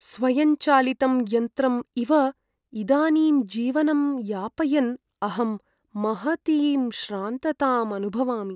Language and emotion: Sanskrit, sad